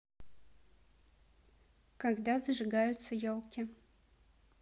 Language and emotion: Russian, neutral